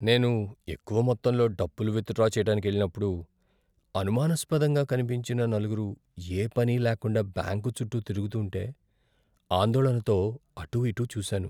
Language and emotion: Telugu, fearful